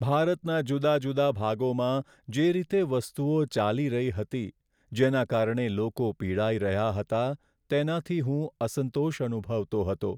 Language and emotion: Gujarati, sad